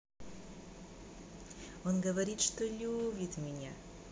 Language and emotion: Russian, positive